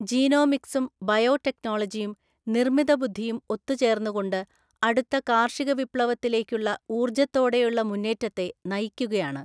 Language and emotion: Malayalam, neutral